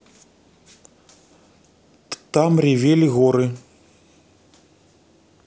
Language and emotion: Russian, neutral